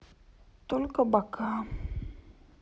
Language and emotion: Russian, sad